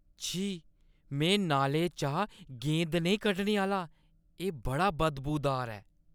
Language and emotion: Dogri, disgusted